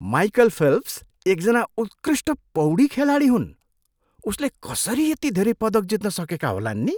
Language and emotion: Nepali, surprised